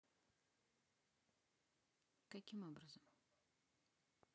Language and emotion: Russian, neutral